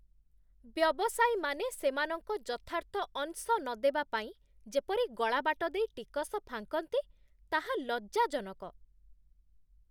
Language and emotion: Odia, disgusted